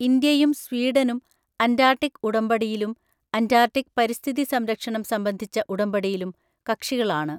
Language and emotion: Malayalam, neutral